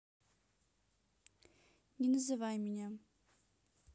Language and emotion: Russian, neutral